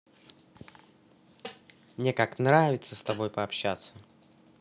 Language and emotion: Russian, positive